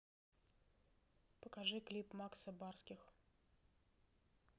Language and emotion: Russian, neutral